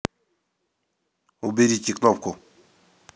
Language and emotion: Russian, neutral